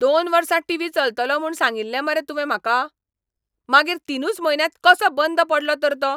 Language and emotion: Goan Konkani, angry